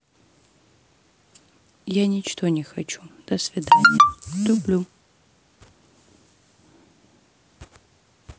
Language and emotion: Russian, sad